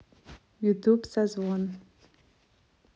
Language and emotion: Russian, neutral